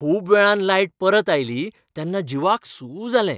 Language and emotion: Goan Konkani, happy